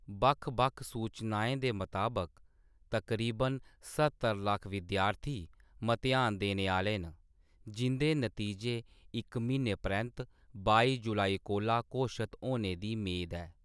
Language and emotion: Dogri, neutral